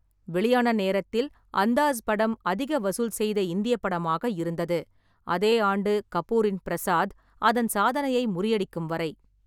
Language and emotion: Tamil, neutral